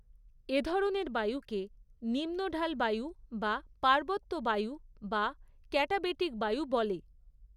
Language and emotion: Bengali, neutral